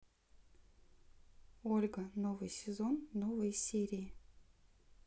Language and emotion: Russian, neutral